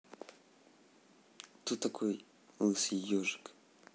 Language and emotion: Russian, neutral